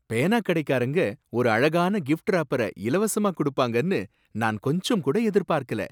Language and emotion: Tamil, surprised